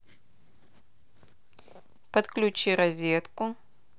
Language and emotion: Russian, neutral